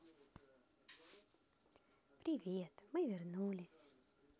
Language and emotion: Russian, positive